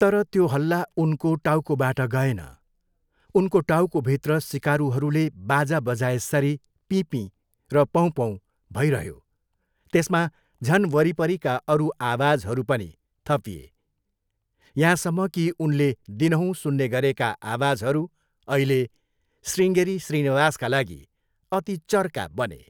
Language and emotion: Nepali, neutral